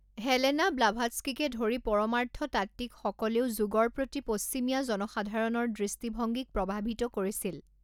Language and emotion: Assamese, neutral